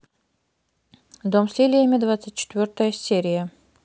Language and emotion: Russian, neutral